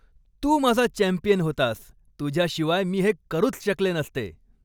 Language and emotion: Marathi, happy